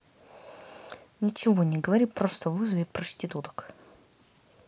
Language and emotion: Russian, angry